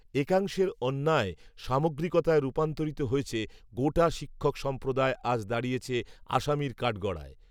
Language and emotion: Bengali, neutral